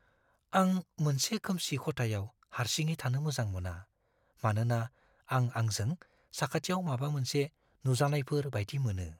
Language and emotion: Bodo, fearful